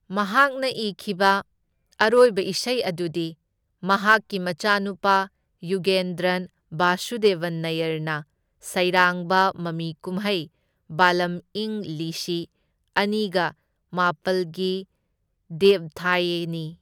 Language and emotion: Manipuri, neutral